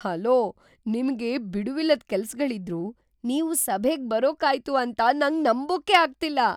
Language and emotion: Kannada, surprised